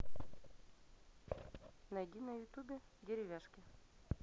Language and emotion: Russian, neutral